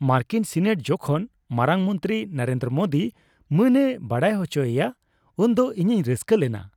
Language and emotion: Santali, happy